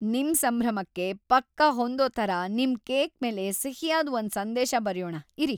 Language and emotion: Kannada, happy